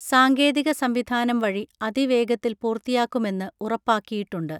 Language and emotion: Malayalam, neutral